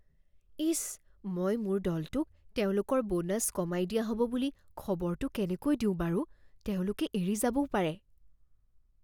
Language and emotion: Assamese, fearful